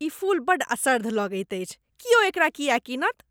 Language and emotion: Maithili, disgusted